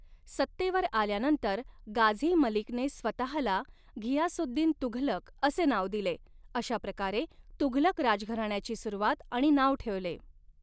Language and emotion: Marathi, neutral